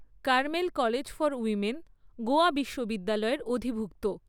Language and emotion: Bengali, neutral